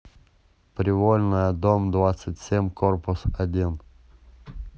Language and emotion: Russian, neutral